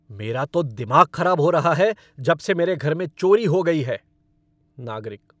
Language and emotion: Hindi, angry